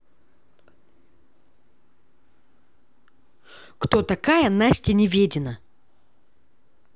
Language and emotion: Russian, angry